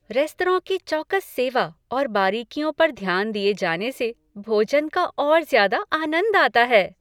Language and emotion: Hindi, happy